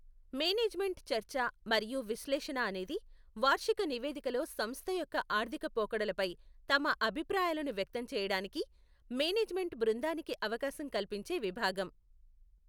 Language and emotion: Telugu, neutral